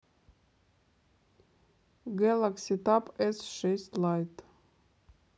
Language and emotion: Russian, neutral